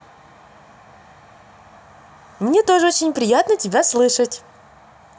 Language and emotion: Russian, positive